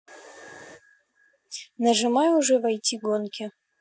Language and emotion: Russian, neutral